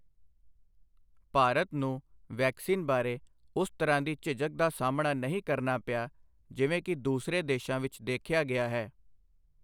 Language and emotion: Punjabi, neutral